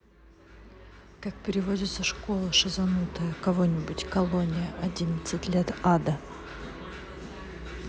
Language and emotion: Russian, neutral